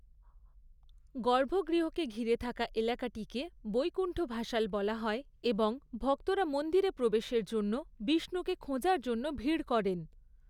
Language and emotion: Bengali, neutral